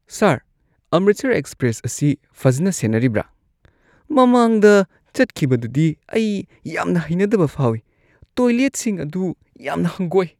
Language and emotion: Manipuri, disgusted